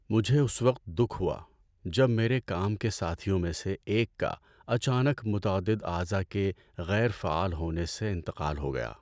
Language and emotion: Urdu, sad